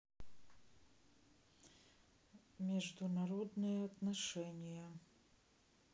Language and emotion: Russian, sad